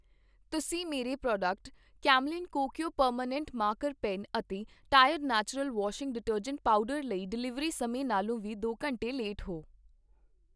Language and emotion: Punjabi, neutral